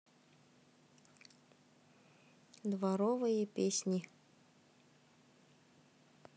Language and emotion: Russian, neutral